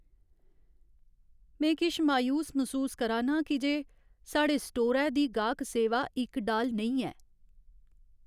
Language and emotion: Dogri, sad